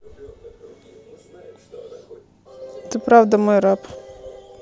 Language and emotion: Russian, neutral